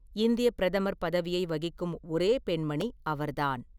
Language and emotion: Tamil, neutral